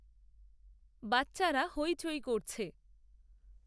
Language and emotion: Bengali, neutral